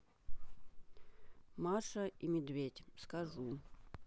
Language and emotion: Russian, neutral